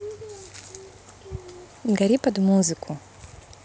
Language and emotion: Russian, neutral